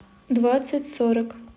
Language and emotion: Russian, neutral